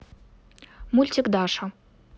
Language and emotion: Russian, neutral